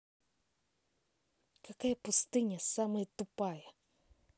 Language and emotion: Russian, angry